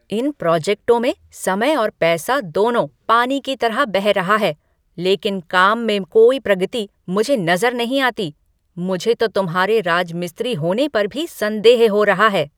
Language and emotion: Hindi, angry